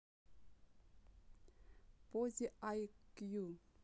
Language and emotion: Russian, neutral